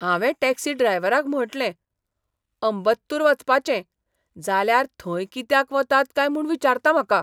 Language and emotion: Goan Konkani, surprised